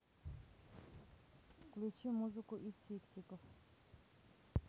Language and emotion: Russian, neutral